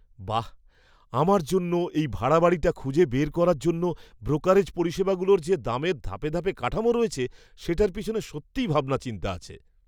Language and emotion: Bengali, surprised